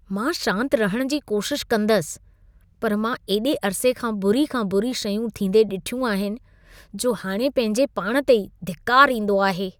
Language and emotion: Sindhi, disgusted